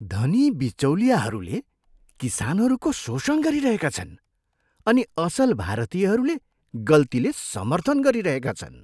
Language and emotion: Nepali, disgusted